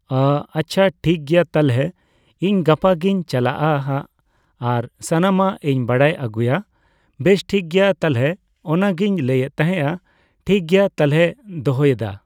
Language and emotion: Santali, neutral